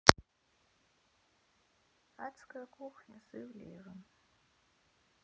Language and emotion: Russian, sad